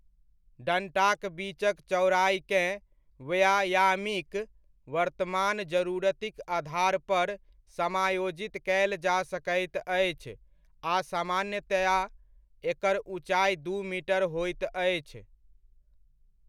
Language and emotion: Maithili, neutral